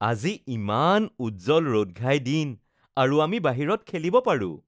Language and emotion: Assamese, happy